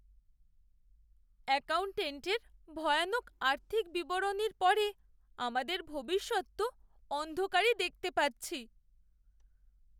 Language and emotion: Bengali, sad